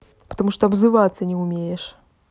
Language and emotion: Russian, angry